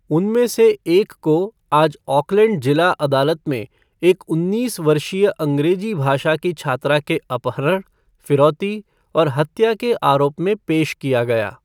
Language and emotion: Hindi, neutral